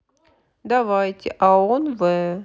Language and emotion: Russian, neutral